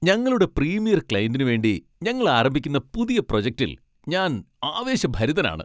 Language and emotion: Malayalam, happy